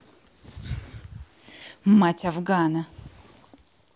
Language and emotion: Russian, angry